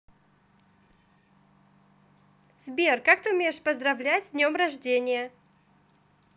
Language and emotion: Russian, positive